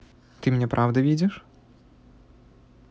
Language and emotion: Russian, neutral